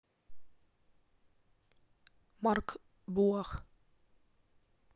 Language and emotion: Russian, neutral